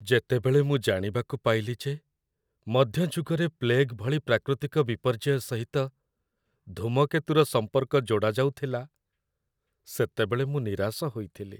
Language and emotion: Odia, sad